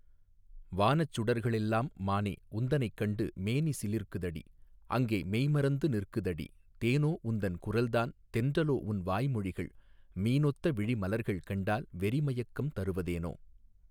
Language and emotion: Tamil, neutral